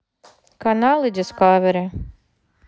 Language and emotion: Russian, neutral